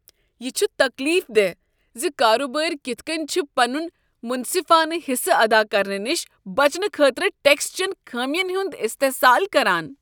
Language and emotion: Kashmiri, disgusted